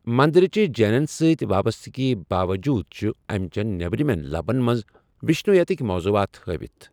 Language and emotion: Kashmiri, neutral